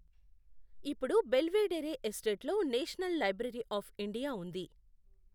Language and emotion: Telugu, neutral